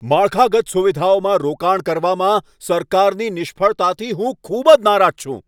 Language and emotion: Gujarati, angry